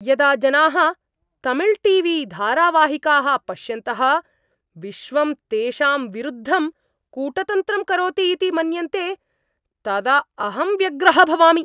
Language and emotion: Sanskrit, angry